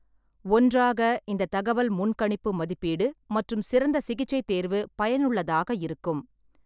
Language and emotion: Tamil, neutral